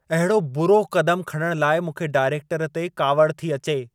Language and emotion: Sindhi, angry